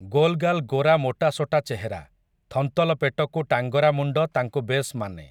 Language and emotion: Odia, neutral